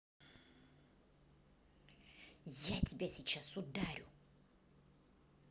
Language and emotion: Russian, angry